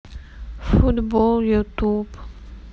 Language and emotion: Russian, sad